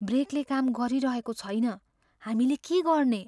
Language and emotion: Nepali, fearful